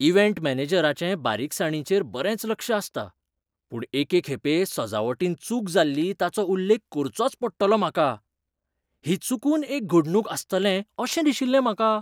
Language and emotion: Goan Konkani, surprised